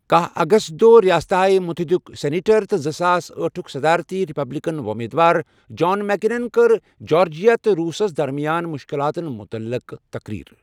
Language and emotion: Kashmiri, neutral